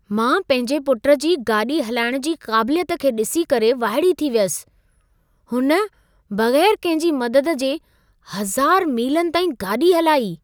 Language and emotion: Sindhi, surprised